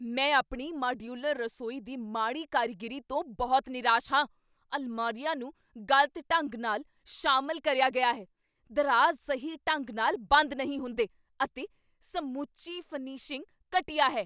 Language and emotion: Punjabi, angry